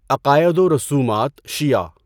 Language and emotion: Urdu, neutral